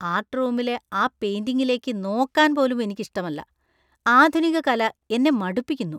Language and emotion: Malayalam, disgusted